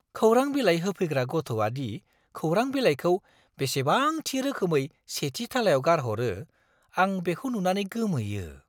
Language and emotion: Bodo, surprised